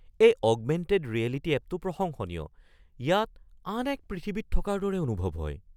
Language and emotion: Assamese, surprised